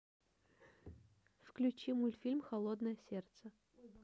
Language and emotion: Russian, neutral